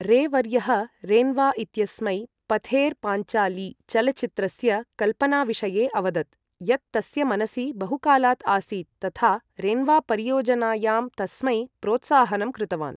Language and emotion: Sanskrit, neutral